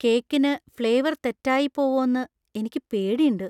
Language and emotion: Malayalam, fearful